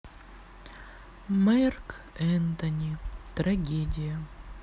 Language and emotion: Russian, sad